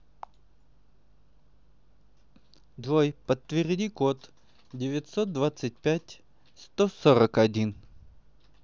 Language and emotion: Russian, neutral